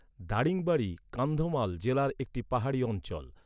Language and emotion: Bengali, neutral